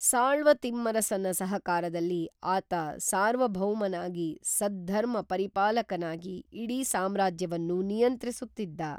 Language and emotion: Kannada, neutral